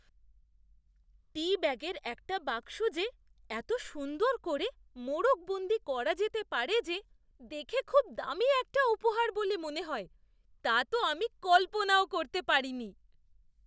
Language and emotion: Bengali, surprised